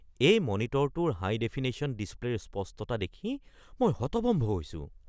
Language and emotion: Assamese, surprised